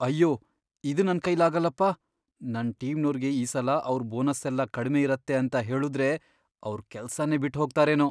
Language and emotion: Kannada, fearful